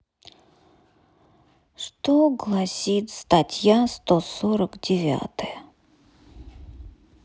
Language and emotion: Russian, sad